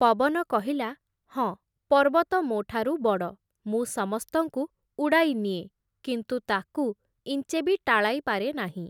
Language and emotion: Odia, neutral